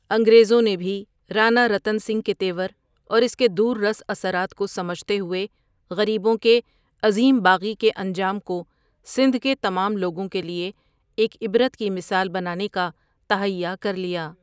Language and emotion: Urdu, neutral